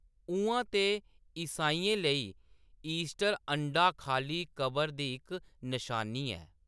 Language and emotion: Dogri, neutral